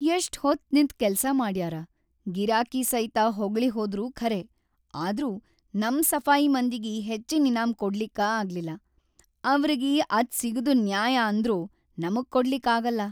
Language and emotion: Kannada, sad